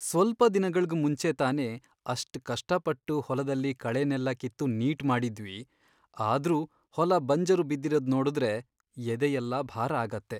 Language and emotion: Kannada, sad